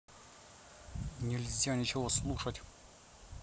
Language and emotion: Russian, angry